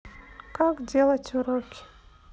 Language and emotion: Russian, neutral